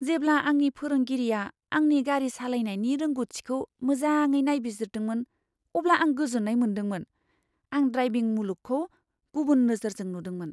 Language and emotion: Bodo, surprised